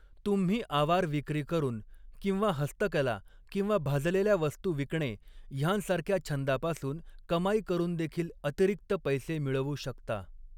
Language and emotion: Marathi, neutral